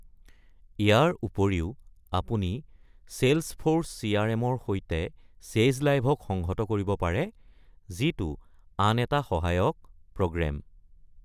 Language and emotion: Assamese, neutral